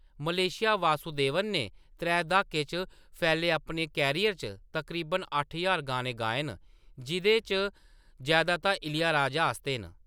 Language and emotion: Dogri, neutral